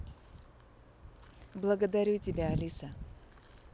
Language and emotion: Russian, neutral